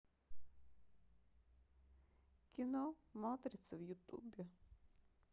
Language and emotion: Russian, sad